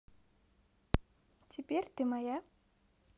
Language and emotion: Russian, positive